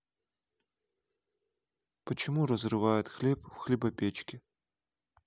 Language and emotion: Russian, neutral